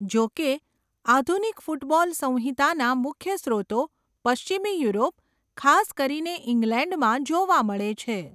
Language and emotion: Gujarati, neutral